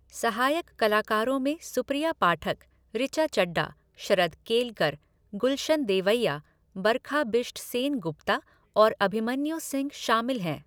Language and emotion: Hindi, neutral